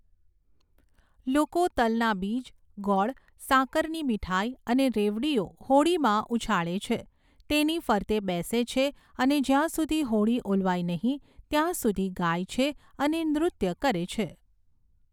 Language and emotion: Gujarati, neutral